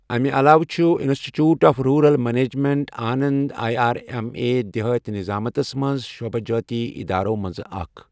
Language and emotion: Kashmiri, neutral